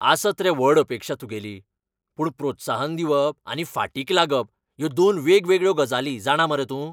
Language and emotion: Goan Konkani, angry